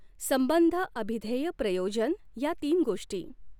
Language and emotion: Marathi, neutral